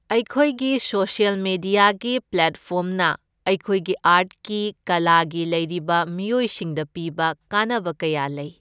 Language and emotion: Manipuri, neutral